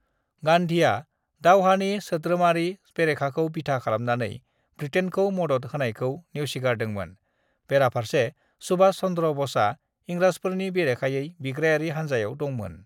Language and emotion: Bodo, neutral